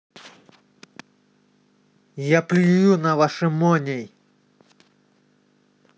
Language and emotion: Russian, angry